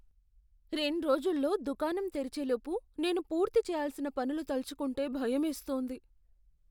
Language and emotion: Telugu, fearful